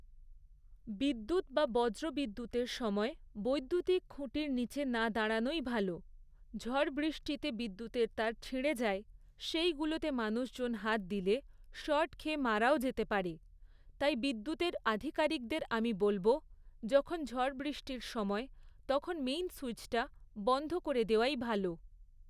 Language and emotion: Bengali, neutral